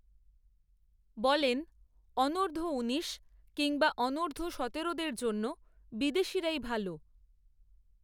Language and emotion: Bengali, neutral